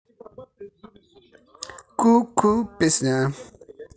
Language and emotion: Russian, positive